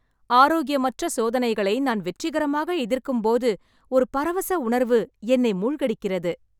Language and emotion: Tamil, happy